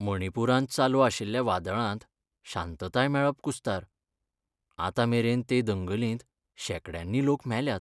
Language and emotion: Goan Konkani, sad